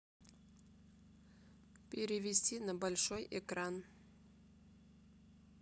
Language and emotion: Russian, neutral